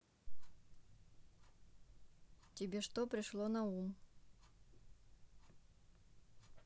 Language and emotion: Russian, neutral